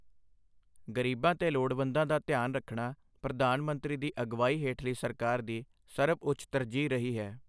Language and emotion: Punjabi, neutral